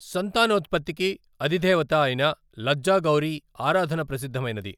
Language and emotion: Telugu, neutral